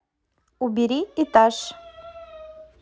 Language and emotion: Russian, neutral